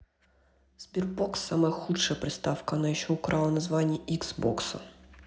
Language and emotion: Russian, angry